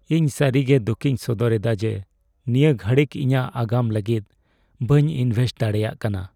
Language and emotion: Santali, sad